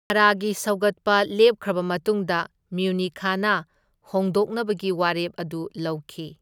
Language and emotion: Manipuri, neutral